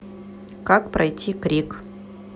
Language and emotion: Russian, neutral